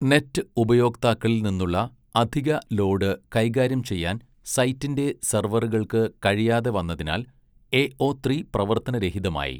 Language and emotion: Malayalam, neutral